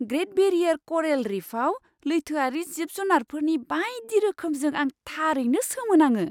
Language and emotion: Bodo, surprised